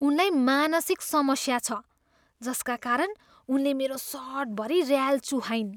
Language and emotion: Nepali, disgusted